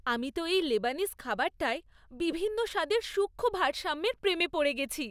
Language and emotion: Bengali, happy